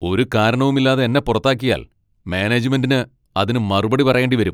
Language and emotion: Malayalam, angry